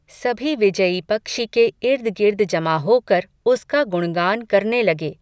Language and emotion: Hindi, neutral